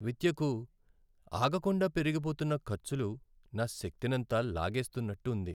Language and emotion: Telugu, sad